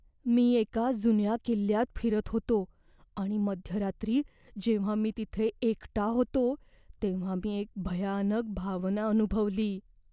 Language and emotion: Marathi, fearful